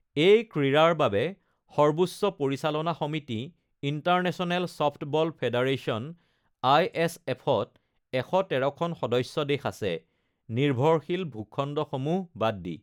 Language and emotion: Assamese, neutral